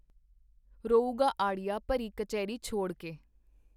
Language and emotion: Punjabi, neutral